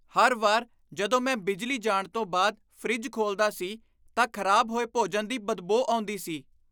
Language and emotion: Punjabi, disgusted